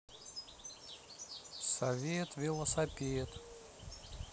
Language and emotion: Russian, neutral